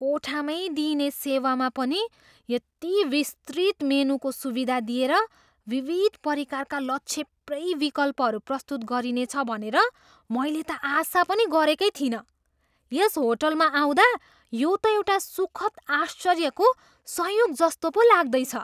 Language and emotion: Nepali, surprised